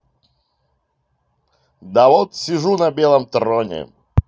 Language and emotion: Russian, positive